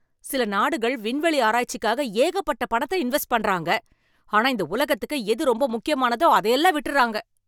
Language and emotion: Tamil, angry